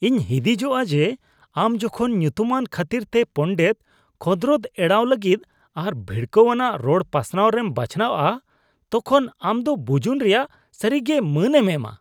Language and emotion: Santali, disgusted